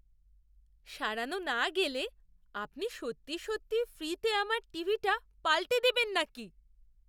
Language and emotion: Bengali, surprised